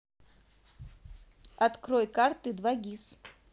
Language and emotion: Russian, neutral